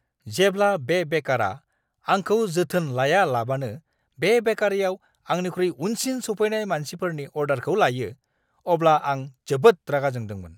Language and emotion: Bodo, angry